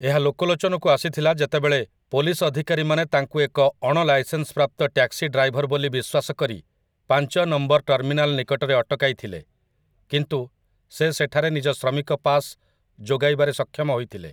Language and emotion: Odia, neutral